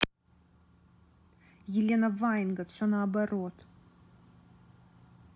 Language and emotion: Russian, angry